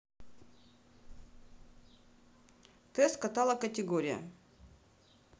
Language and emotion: Russian, neutral